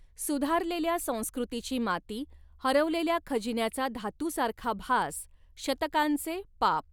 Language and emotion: Marathi, neutral